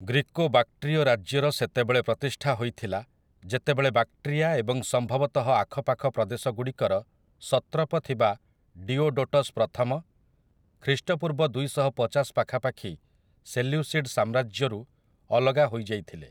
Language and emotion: Odia, neutral